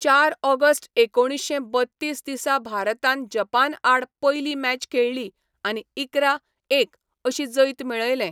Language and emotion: Goan Konkani, neutral